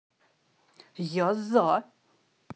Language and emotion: Russian, neutral